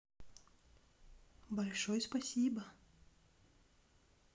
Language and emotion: Russian, neutral